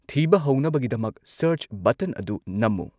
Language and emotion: Manipuri, neutral